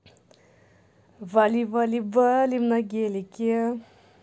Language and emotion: Russian, positive